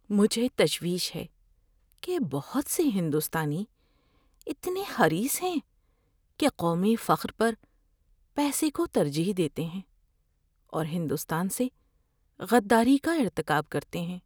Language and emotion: Urdu, fearful